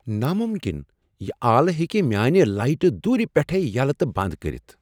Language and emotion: Kashmiri, surprised